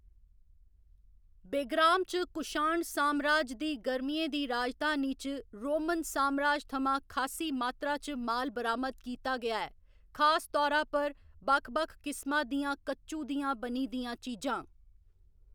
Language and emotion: Dogri, neutral